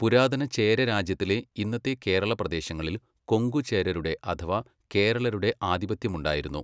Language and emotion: Malayalam, neutral